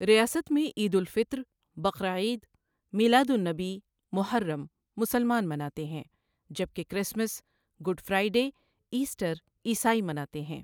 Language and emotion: Urdu, neutral